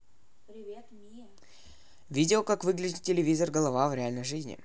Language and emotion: Russian, neutral